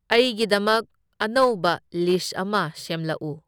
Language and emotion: Manipuri, neutral